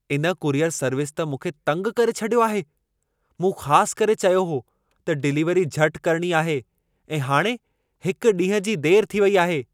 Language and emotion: Sindhi, angry